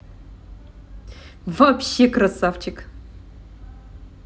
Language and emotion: Russian, positive